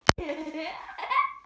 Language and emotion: Russian, positive